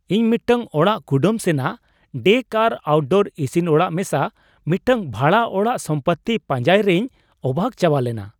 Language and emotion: Santali, surprised